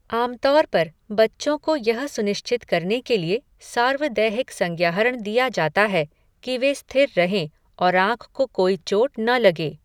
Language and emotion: Hindi, neutral